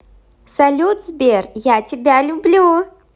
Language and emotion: Russian, positive